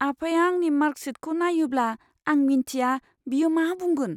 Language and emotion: Bodo, fearful